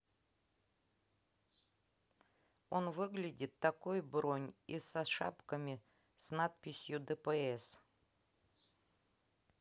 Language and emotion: Russian, neutral